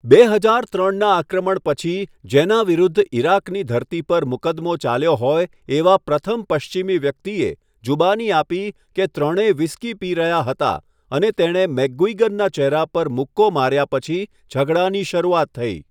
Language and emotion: Gujarati, neutral